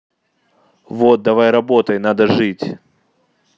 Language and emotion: Russian, neutral